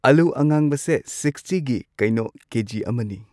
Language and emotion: Manipuri, neutral